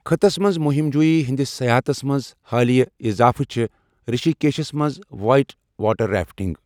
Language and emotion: Kashmiri, neutral